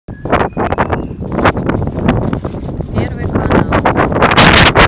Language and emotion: Russian, neutral